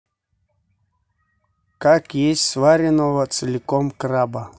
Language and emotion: Russian, neutral